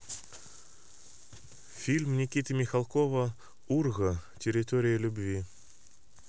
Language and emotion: Russian, neutral